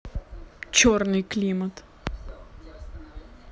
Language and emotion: Russian, neutral